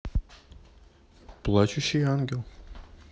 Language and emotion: Russian, neutral